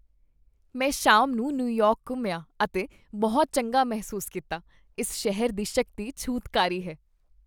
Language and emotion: Punjabi, happy